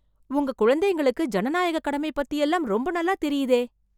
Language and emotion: Tamil, surprised